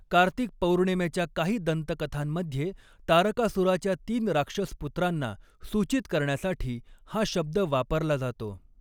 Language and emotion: Marathi, neutral